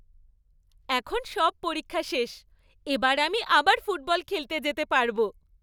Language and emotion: Bengali, happy